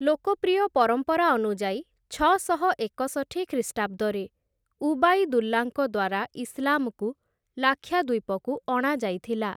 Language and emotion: Odia, neutral